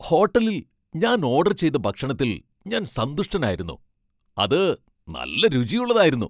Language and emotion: Malayalam, happy